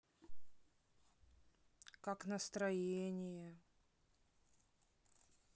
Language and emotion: Russian, sad